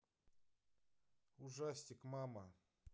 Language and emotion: Russian, neutral